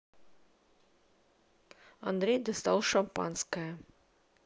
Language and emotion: Russian, neutral